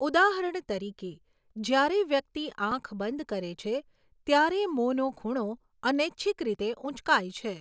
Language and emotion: Gujarati, neutral